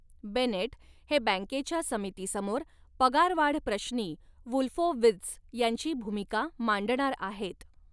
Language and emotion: Marathi, neutral